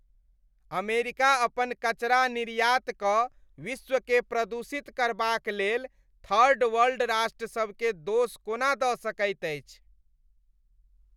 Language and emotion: Maithili, disgusted